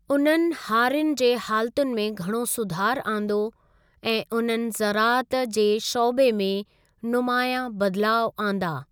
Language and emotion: Sindhi, neutral